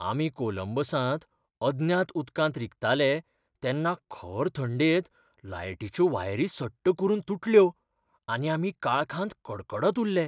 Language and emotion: Goan Konkani, fearful